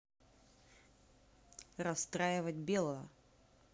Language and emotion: Russian, neutral